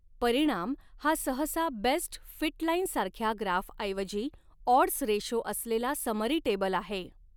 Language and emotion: Marathi, neutral